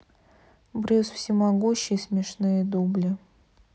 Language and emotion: Russian, neutral